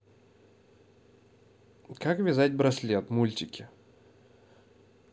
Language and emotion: Russian, neutral